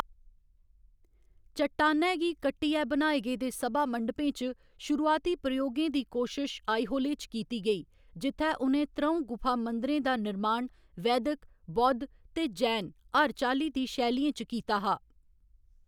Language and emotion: Dogri, neutral